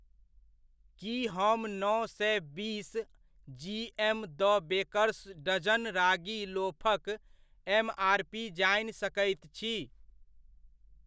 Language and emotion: Maithili, neutral